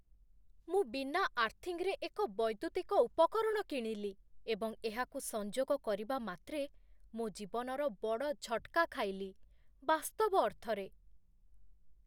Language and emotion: Odia, fearful